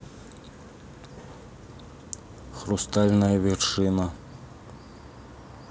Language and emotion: Russian, neutral